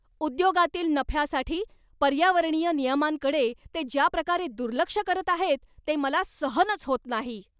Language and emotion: Marathi, angry